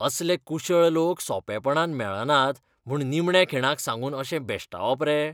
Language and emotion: Goan Konkani, disgusted